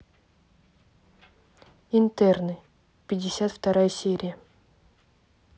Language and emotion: Russian, neutral